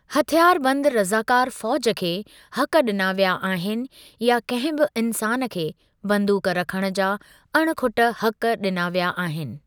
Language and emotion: Sindhi, neutral